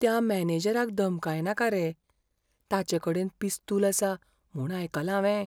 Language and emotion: Goan Konkani, fearful